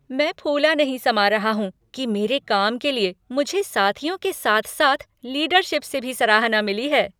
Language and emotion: Hindi, happy